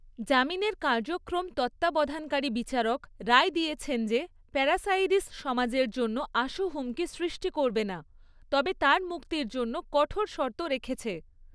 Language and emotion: Bengali, neutral